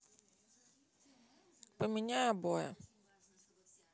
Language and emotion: Russian, neutral